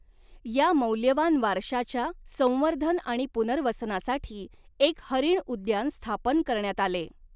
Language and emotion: Marathi, neutral